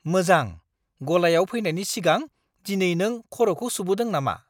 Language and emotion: Bodo, surprised